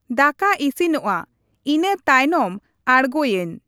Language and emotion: Santali, neutral